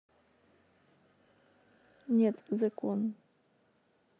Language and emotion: Russian, neutral